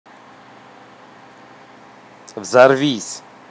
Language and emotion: Russian, angry